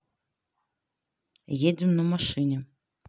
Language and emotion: Russian, neutral